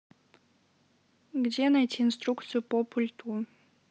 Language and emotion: Russian, neutral